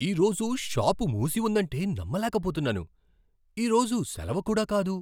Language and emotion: Telugu, surprised